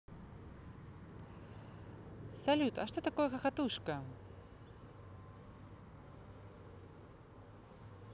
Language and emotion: Russian, positive